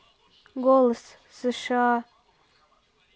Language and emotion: Russian, neutral